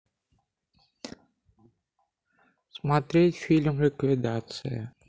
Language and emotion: Russian, neutral